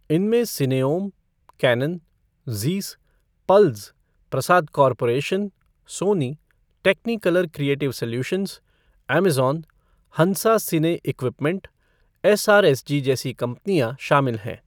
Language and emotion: Hindi, neutral